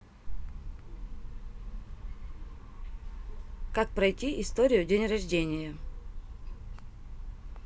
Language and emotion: Russian, neutral